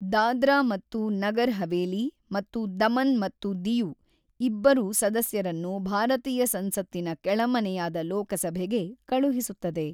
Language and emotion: Kannada, neutral